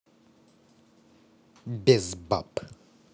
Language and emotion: Russian, neutral